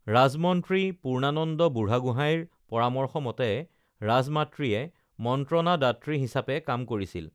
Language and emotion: Assamese, neutral